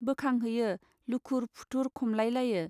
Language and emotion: Bodo, neutral